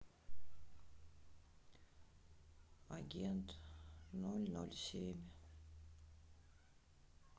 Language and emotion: Russian, sad